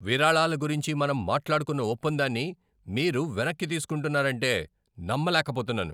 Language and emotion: Telugu, angry